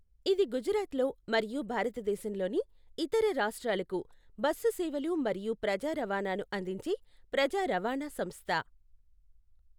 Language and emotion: Telugu, neutral